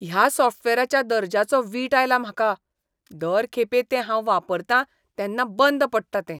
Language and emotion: Goan Konkani, disgusted